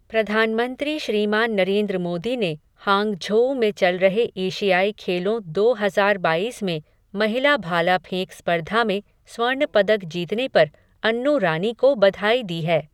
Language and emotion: Hindi, neutral